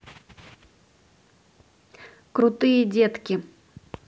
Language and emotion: Russian, neutral